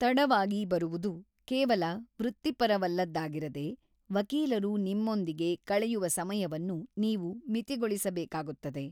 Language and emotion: Kannada, neutral